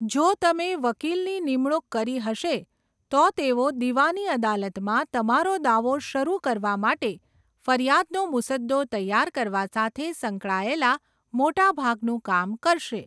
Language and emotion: Gujarati, neutral